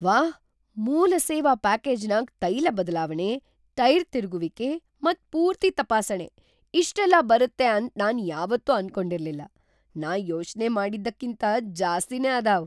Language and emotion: Kannada, surprised